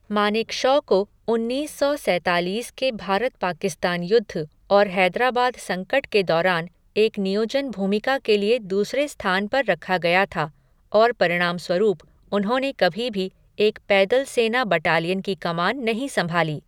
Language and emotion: Hindi, neutral